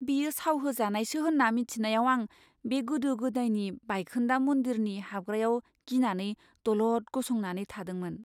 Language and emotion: Bodo, fearful